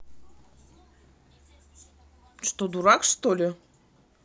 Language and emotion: Russian, angry